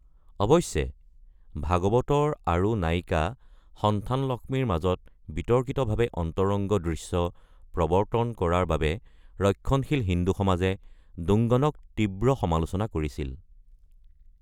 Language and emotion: Assamese, neutral